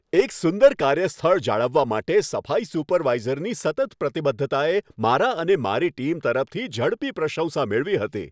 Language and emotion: Gujarati, happy